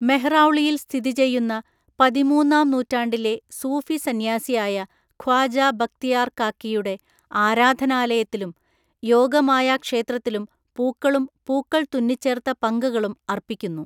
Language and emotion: Malayalam, neutral